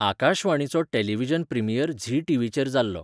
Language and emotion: Goan Konkani, neutral